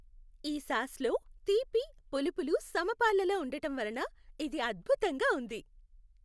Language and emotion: Telugu, happy